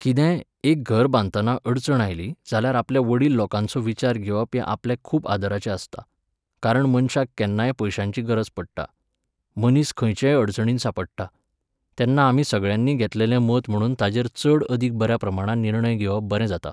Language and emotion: Goan Konkani, neutral